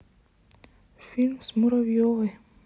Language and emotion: Russian, sad